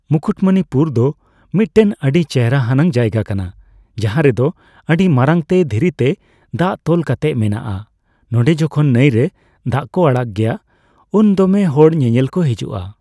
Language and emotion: Santali, neutral